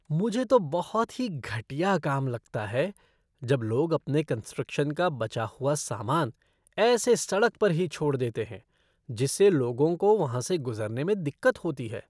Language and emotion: Hindi, disgusted